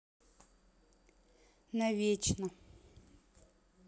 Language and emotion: Russian, neutral